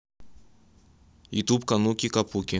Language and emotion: Russian, neutral